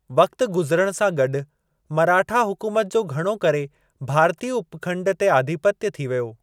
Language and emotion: Sindhi, neutral